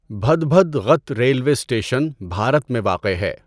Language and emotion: Urdu, neutral